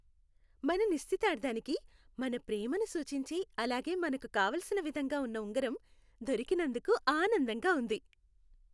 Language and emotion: Telugu, happy